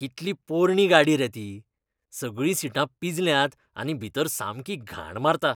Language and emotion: Goan Konkani, disgusted